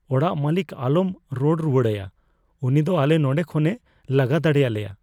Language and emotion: Santali, fearful